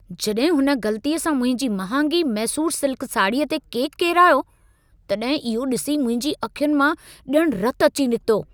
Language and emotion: Sindhi, angry